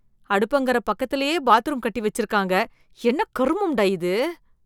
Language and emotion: Tamil, disgusted